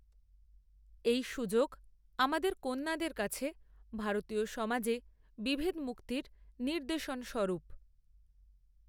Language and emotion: Bengali, neutral